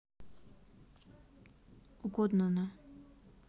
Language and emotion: Russian, neutral